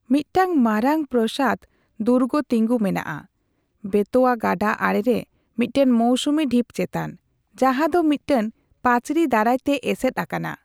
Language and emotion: Santali, neutral